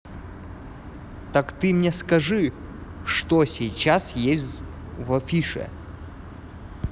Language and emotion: Russian, neutral